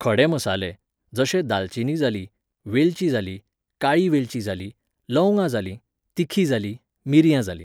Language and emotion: Goan Konkani, neutral